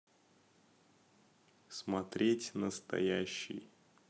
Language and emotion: Russian, neutral